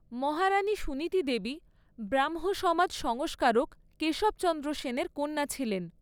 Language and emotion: Bengali, neutral